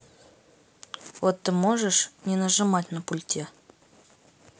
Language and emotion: Russian, neutral